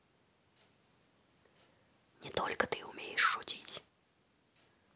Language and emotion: Russian, neutral